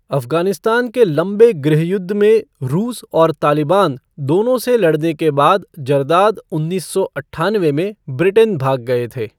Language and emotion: Hindi, neutral